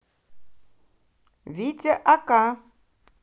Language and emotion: Russian, positive